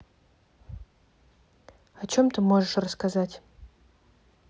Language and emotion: Russian, neutral